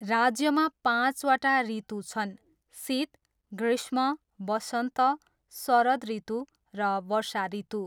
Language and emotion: Nepali, neutral